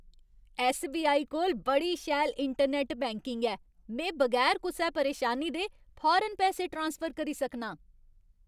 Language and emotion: Dogri, happy